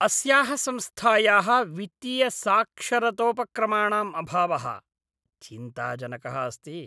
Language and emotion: Sanskrit, disgusted